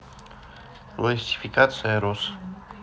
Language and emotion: Russian, neutral